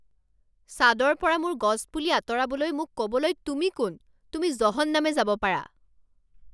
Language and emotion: Assamese, angry